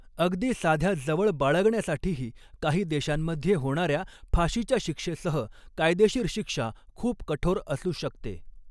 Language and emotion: Marathi, neutral